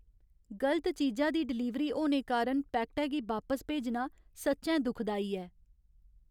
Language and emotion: Dogri, sad